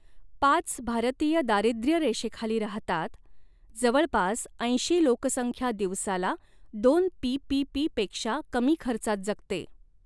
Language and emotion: Marathi, neutral